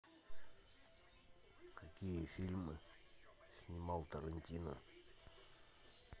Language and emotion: Russian, neutral